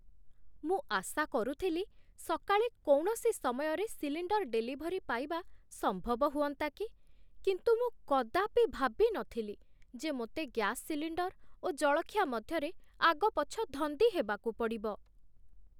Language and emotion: Odia, surprised